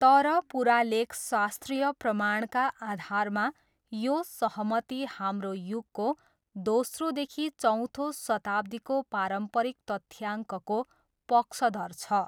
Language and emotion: Nepali, neutral